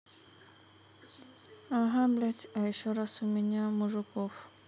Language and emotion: Russian, sad